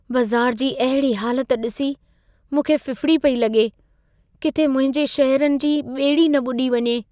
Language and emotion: Sindhi, fearful